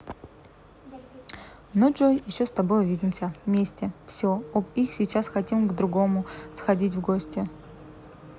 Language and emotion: Russian, neutral